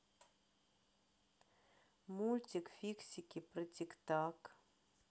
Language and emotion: Russian, neutral